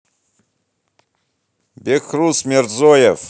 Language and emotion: Russian, angry